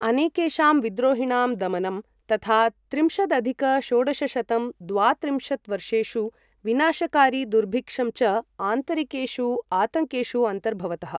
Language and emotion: Sanskrit, neutral